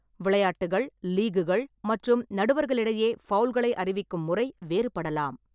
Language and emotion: Tamil, neutral